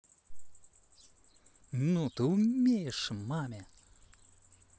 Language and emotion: Russian, positive